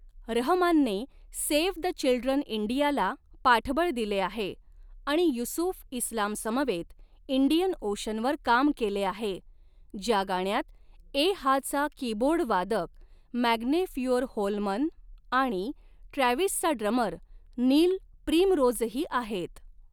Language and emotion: Marathi, neutral